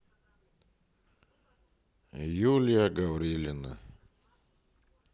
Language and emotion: Russian, sad